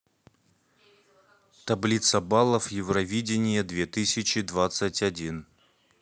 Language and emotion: Russian, neutral